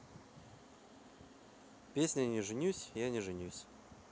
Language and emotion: Russian, neutral